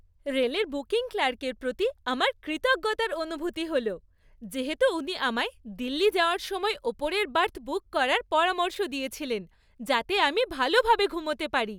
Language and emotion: Bengali, happy